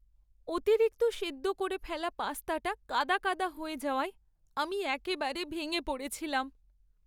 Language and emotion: Bengali, sad